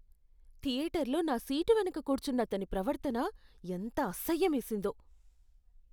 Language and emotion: Telugu, disgusted